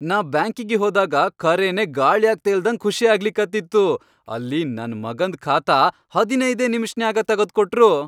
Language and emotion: Kannada, happy